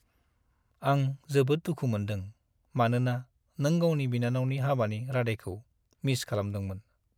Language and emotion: Bodo, sad